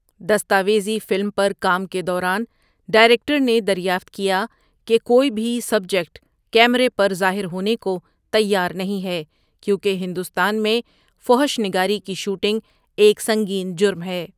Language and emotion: Urdu, neutral